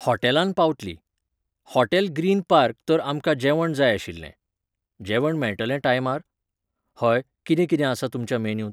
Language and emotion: Goan Konkani, neutral